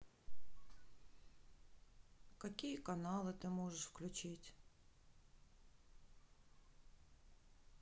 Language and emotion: Russian, sad